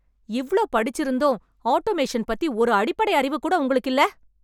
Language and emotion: Tamil, angry